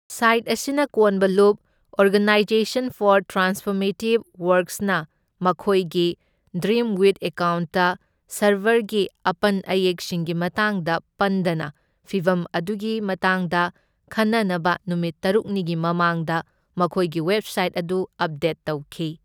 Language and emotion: Manipuri, neutral